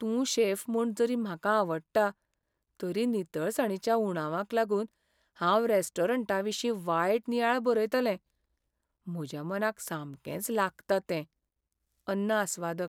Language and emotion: Goan Konkani, sad